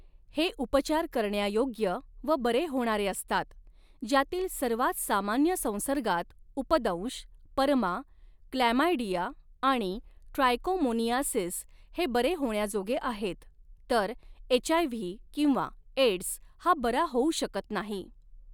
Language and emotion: Marathi, neutral